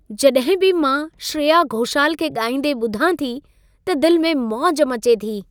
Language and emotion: Sindhi, happy